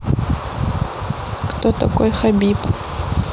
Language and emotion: Russian, neutral